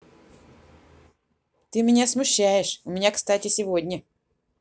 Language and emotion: Russian, neutral